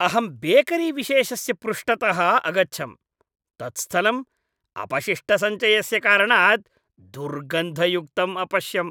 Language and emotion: Sanskrit, disgusted